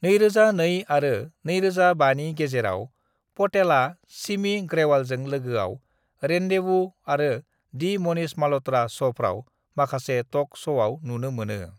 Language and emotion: Bodo, neutral